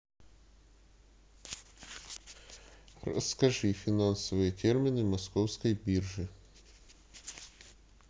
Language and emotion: Russian, neutral